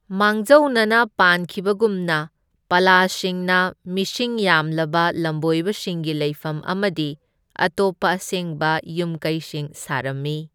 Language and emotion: Manipuri, neutral